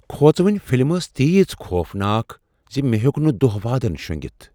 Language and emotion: Kashmiri, fearful